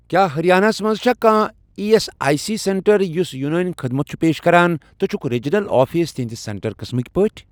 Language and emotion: Kashmiri, neutral